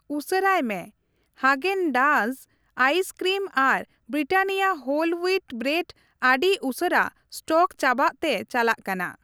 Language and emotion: Santali, neutral